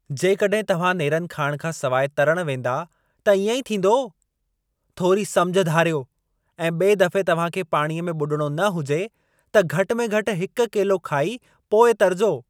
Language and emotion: Sindhi, angry